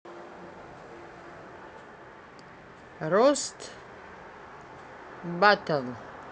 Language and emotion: Russian, neutral